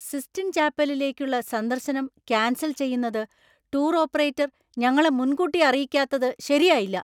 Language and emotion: Malayalam, angry